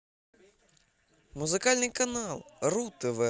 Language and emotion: Russian, positive